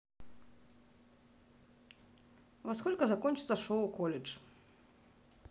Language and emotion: Russian, neutral